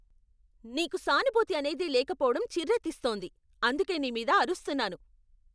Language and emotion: Telugu, angry